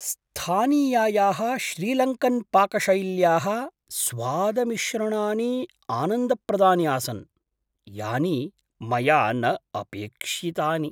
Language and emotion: Sanskrit, surprised